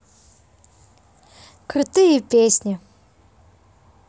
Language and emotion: Russian, positive